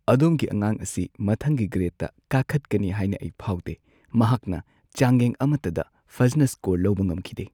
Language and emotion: Manipuri, sad